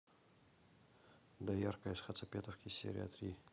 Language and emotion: Russian, neutral